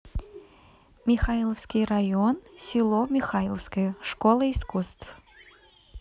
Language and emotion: Russian, neutral